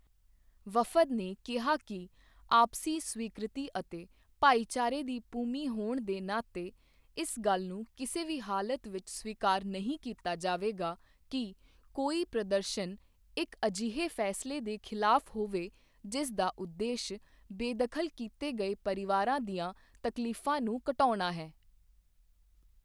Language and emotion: Punjabi, neutral